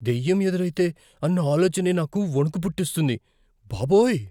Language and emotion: Telugu, fearful